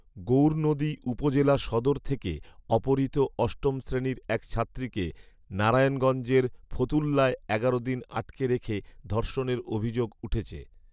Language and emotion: Bengali, neutral